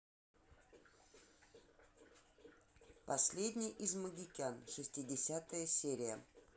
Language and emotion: Russian, neutral